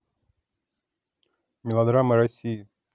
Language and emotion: Russian, neutral